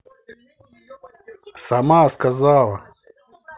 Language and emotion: Russian, angry